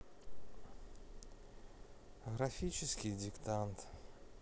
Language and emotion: Russian, sad